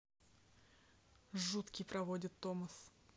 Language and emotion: Russian, neutral